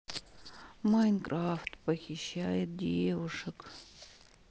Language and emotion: Russian, sad